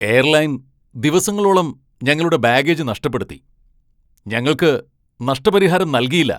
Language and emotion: Malayalam, angry